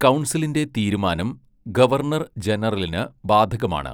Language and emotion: Malayalam, neutral